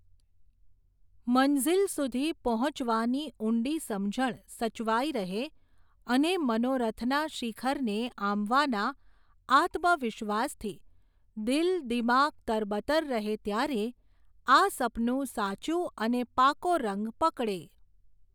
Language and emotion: Gujarati, neutral